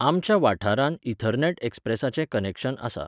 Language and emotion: Goan Konkani, neutral